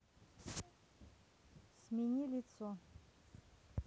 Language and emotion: Russian, neutral